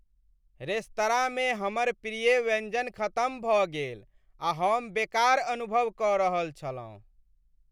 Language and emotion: Maithili, sad